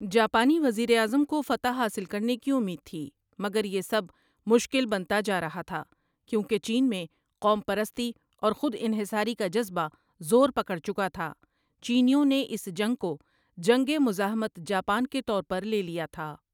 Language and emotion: Urdu, neutral